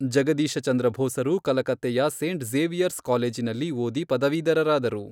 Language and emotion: Kannada, neutral